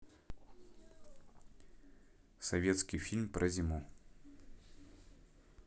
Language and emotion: Russian, neutral